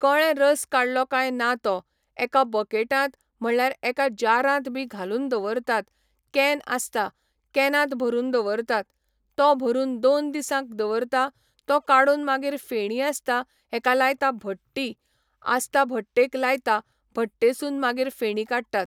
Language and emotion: Goan Konkani, neutral